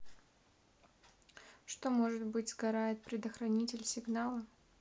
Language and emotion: Russian, neutral